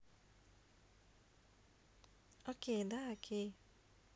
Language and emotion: Russian, neutral